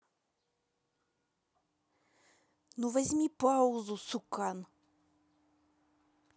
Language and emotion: Russian, angry